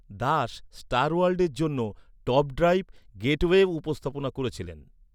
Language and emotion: Bengali, neutral